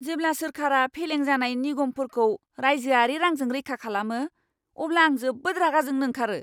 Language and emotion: Bodo, angry